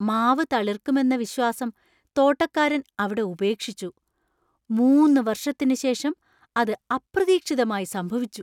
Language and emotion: Malayalam, surprised